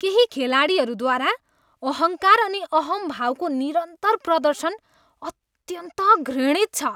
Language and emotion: Nepali, disgusted